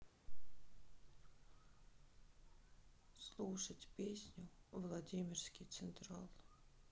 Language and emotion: Russian, sad